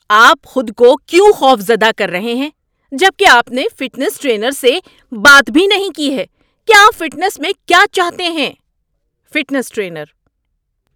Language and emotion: Urdu, angry